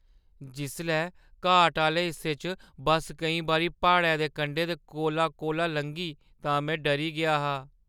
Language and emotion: Dogri, fearful